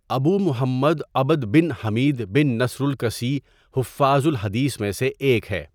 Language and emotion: Urdu, neutral